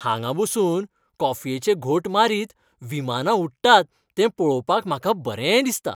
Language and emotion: Goan Konkani, happy